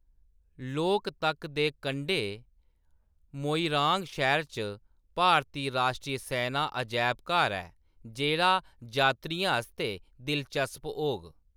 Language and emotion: Dogri, neutral